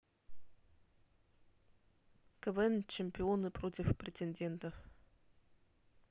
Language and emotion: Russian, neutral